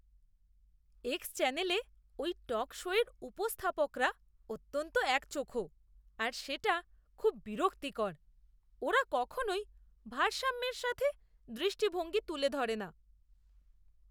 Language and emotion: Bengali, disgusted